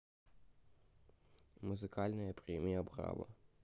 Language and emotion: Russian, neutral